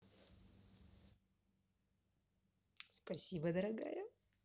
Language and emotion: Russian, positive